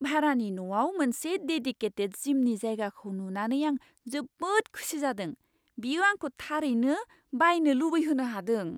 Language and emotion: Bodo, surprised